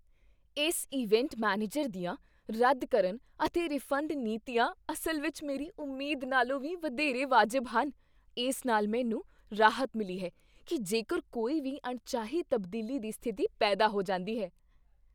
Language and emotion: Punjabi, surprised